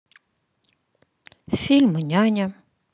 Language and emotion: Russian, neutral